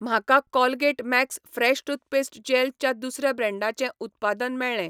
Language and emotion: Goan Konkani, neutral